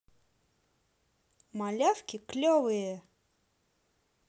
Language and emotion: Russian, positive